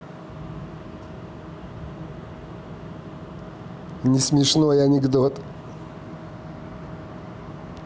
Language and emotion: Russian, positive